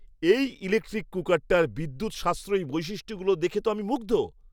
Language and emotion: Bengali, surprised